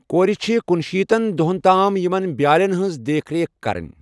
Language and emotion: Kashmiri, neutral